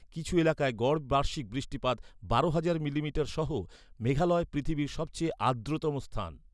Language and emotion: Bengali, neutral